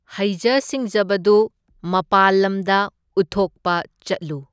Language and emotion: Manipuri, neutral